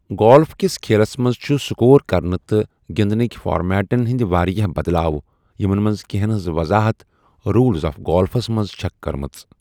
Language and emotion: Kashmiri, neutral